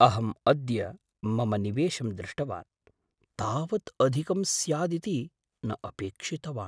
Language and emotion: Sanskrit, surprised